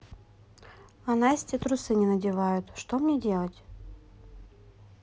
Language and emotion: Russian, neutral